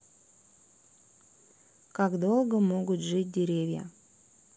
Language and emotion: Russian, neutral